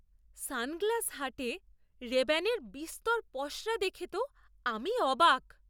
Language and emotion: Bengali, surprised